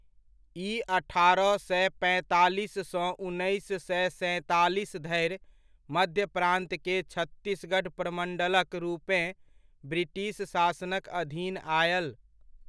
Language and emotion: Maithili, neutral